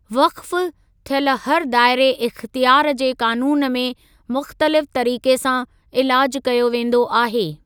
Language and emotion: Sindhi, neutral